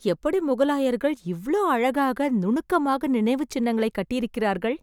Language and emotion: Tamil, surprised